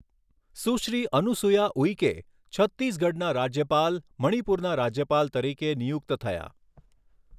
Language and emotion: Gujarati, neutral